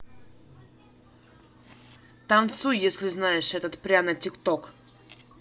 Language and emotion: Russian, angry